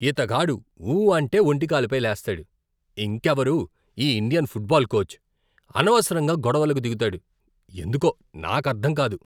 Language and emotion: Telugu, disgusted